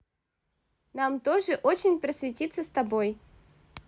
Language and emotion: Russian, neutral